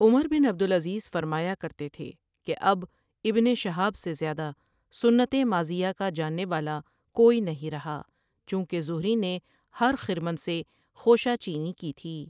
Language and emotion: Urdu, neutral